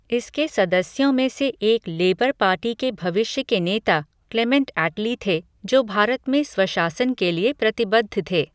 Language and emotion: Hindi, neutral